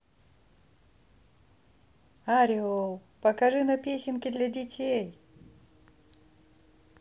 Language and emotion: Russian, positive